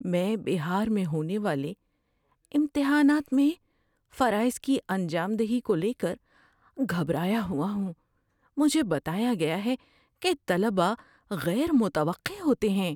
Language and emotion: Urdu, fearful